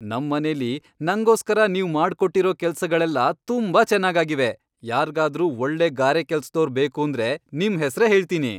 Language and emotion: Kannada, happy